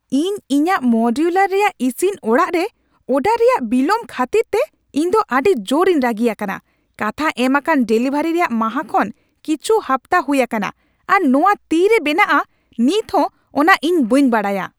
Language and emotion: Santali, angry